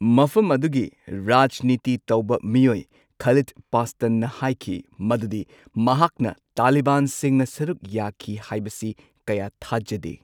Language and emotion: Manipuri, neutral